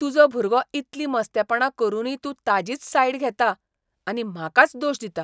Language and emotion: Goan Konkani, disgusted